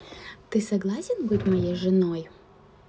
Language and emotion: Russian, neutral